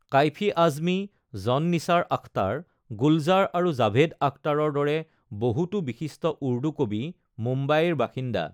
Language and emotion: Assamese, neutral